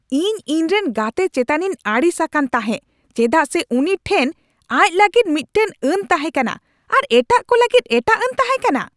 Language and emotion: Santali, angry